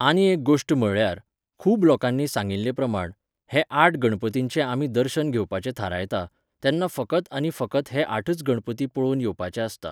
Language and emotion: Goan Konkani, neutral